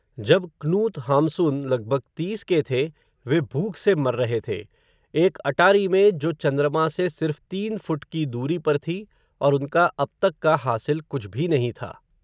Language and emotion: Hindi, neutral